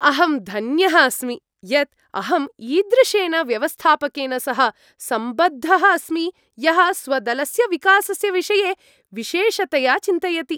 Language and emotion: Sanskrit, happy